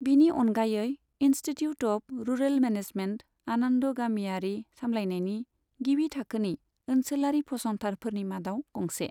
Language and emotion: Bodo, neutral